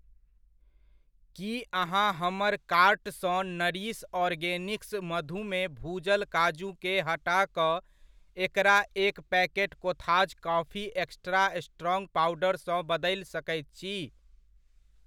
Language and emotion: Maithili, neutral